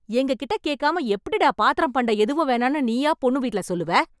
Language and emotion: Tamil, angry